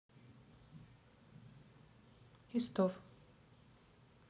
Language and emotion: Russian, neutral